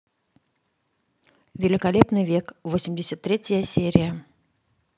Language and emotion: Russian, neutral